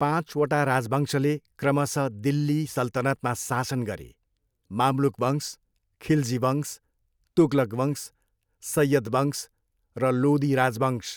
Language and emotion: Nepali, neutral